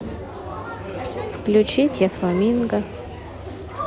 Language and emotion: Russian, neutral